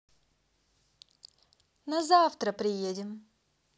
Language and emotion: Russian, positive